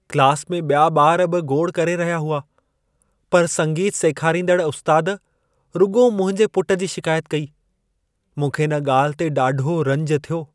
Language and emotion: Sindhi, sad